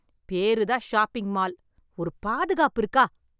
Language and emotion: Tamil, angry